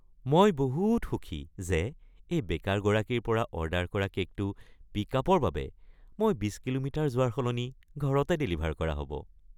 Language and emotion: Assamese, happy